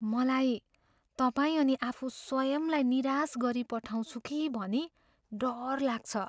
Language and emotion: Nepali, fearful